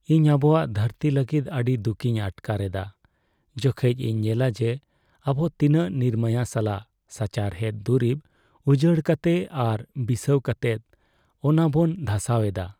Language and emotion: Santali, sad